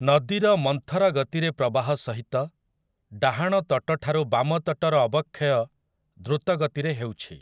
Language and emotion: Odia, neutral